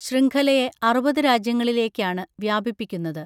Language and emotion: Malayalam, neutral